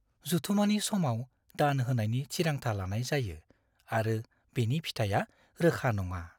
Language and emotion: Bodo, fearful